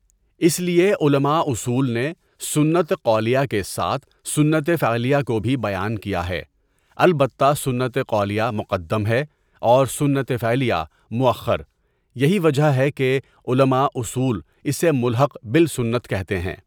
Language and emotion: Urdu, neutral